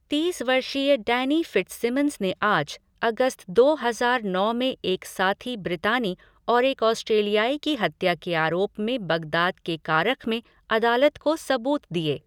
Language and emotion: Hindi, neutral